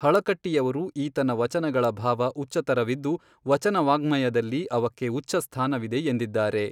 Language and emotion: Kannada, neutral